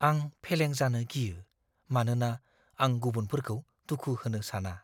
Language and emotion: Bodo, fearful